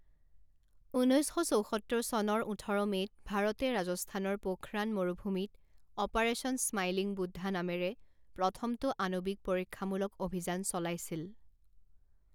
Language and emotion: Assamese, neutral